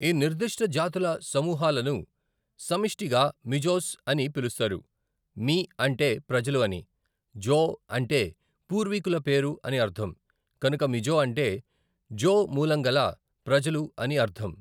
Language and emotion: Telugu, neutral